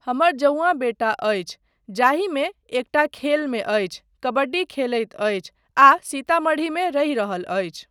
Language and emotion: Maithili, neutral